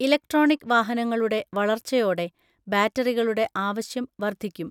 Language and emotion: Malayalam, neutral